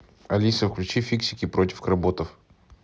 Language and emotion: Russian, neutral